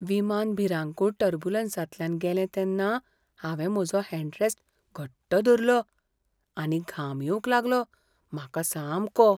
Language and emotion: Goan Konkani, fearful